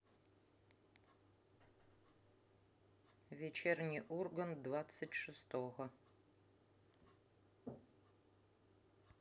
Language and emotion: Russian, neutral